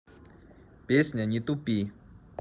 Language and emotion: Russian, neutral